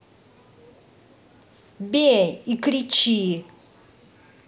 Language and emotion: Russian, angry